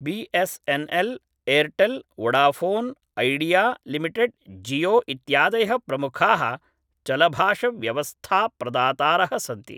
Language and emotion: Sanskrit, neutral